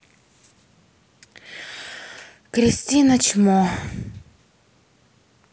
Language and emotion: Russian, sad